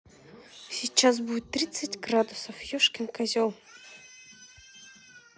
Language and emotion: Russian, neutral